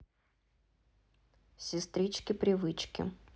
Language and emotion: Russian, neutral